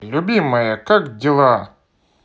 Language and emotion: Russian, positive